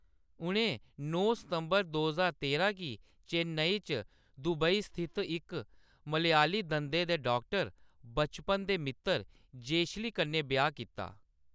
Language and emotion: Dogri, neutral